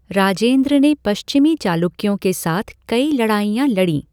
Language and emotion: Hindi, neutral